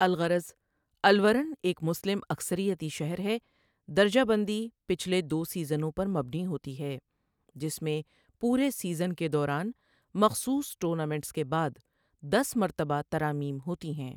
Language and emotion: Urdu, neutral